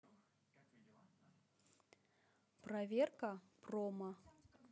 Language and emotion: Russian, neutral